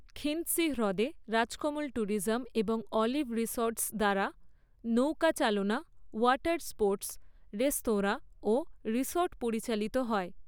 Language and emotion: Bengali, neutral